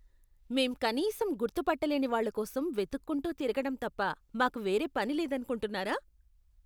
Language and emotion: Telugu, disgusted